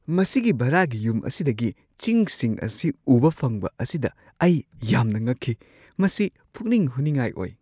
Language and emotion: Manipuri, surprised